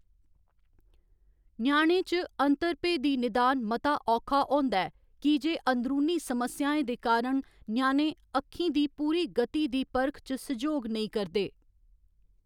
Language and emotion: Dogri, neutral